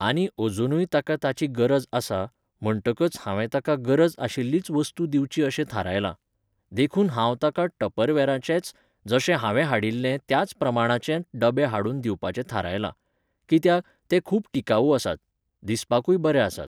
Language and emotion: Goan Konkani, neutral